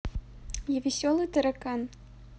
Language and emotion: Russian, neutral